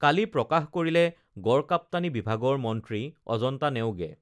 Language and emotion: Assamese, neutral